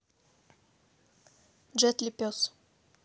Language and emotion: Russian, neutral